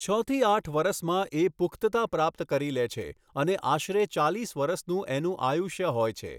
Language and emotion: Gujarati, neutral